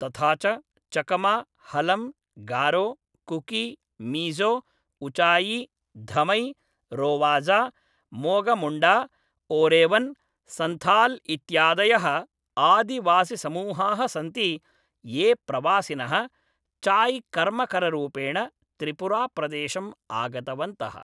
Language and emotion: Sanskrit, neutral